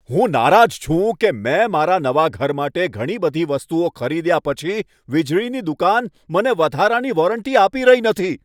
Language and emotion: Gujarati, angry